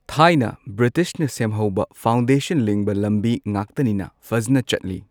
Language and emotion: Manipuri, neutral